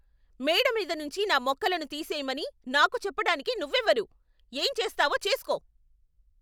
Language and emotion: Telugu, angry